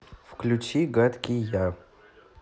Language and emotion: Russian, neutral